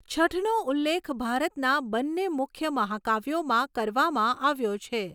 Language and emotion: Gujarati, neutral